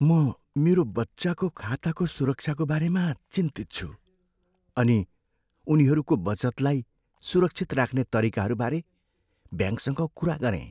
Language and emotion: Nepali, fearful